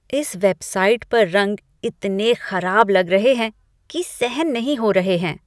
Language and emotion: Hindi, disgusted